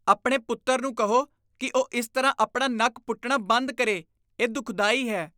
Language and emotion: Punjabi, disgusted